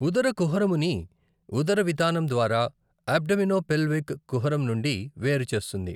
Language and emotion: Telugu, neutral